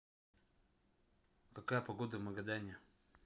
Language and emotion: Russian, neutral